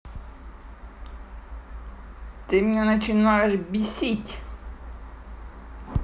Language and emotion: Russian, angry